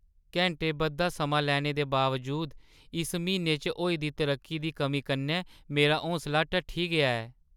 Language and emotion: Dogri, sad